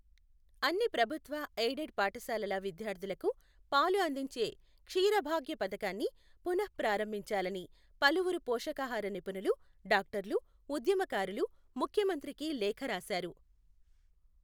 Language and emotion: Telugu, neutral